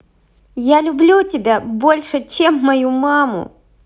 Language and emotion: Russian, positive